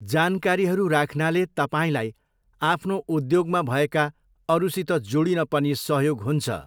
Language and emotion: Nepali, neutral